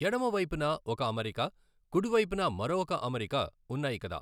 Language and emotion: Telugu, neutral